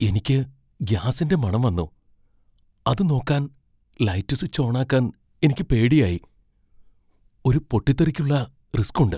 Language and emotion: Malayalam, fearful